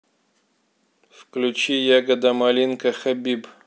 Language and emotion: Russian, neutral